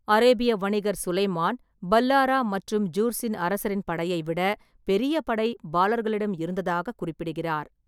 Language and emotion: Tamil, neutral